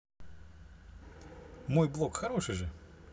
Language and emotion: Russian, positive